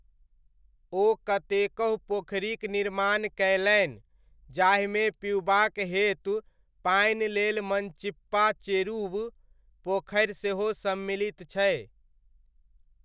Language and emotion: Maithili, neutral